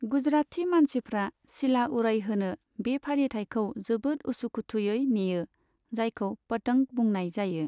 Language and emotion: Bodo, neutral